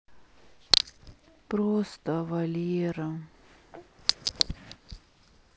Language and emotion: Russian, sad